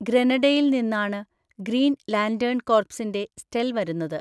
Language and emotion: Malayalam, neutral